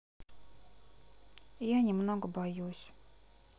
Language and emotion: Russian, sad